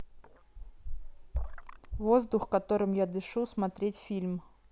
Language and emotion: Russian, neutral